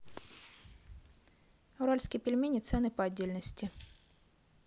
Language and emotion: Russian, neutral